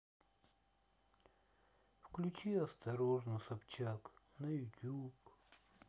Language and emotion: Russian, sad